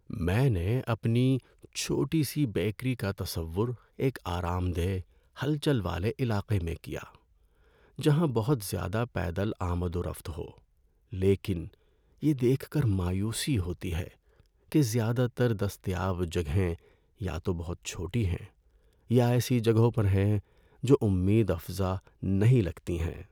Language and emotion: Urdu, sad